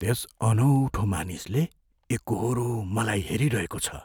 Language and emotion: Nepali, fearful